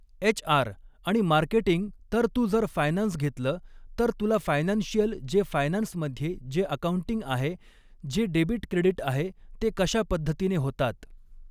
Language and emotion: Marathi, neutral